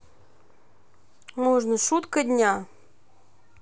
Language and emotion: Russian, neutral